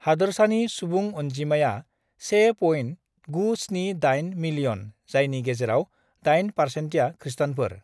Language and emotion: Bodo, neutral